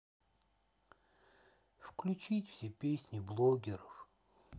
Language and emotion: Russian, sad